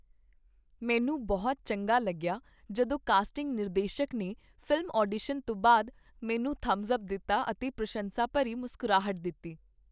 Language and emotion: Punjabi, happy